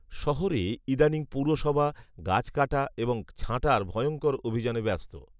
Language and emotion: Bengali, neutral